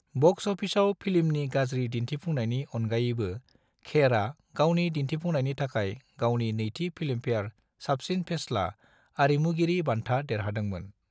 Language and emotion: Bodo, neutral